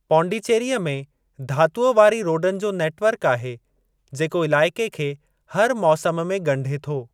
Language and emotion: Sindhi, neutral